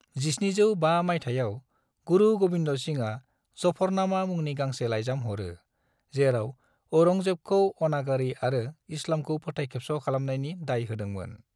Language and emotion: Bodo, neutral